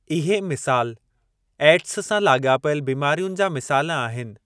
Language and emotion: Sindhi, neutral